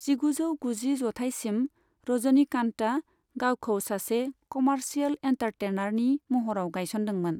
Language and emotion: Bodo, neutral